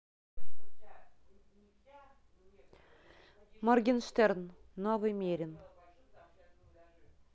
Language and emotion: Russian, neutral